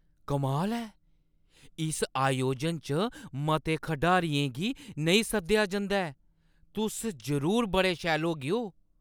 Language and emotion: Dogri, surprised